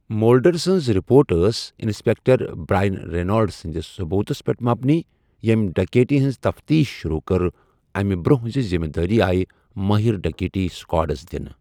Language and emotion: Kashmiri, neutral